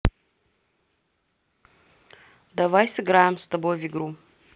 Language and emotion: Russian, neutral